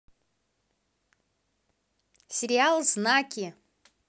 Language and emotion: Russian, positive